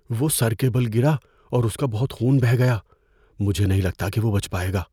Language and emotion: Urdu, fearful